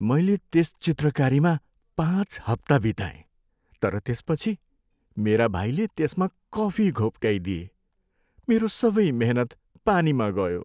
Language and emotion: Nepali, sad